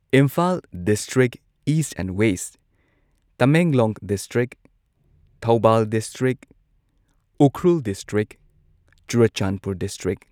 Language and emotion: Manipuri, neutral